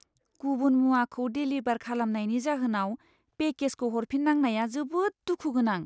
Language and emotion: Bodo, sad